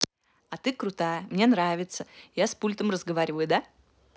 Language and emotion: Russian, positive